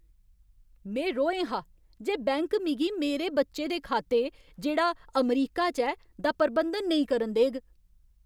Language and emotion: Dogri, angry